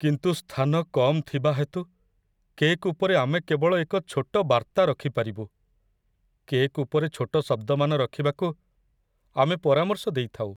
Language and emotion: Odia, sad